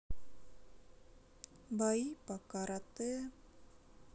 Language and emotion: Russian, sad